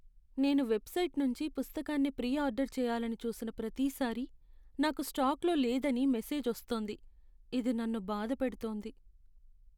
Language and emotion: Telugu, sad